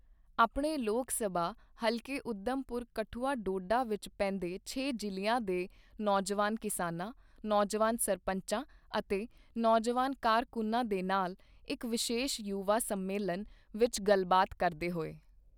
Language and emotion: Punjabi, neutral